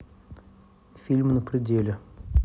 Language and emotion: Russian, neutral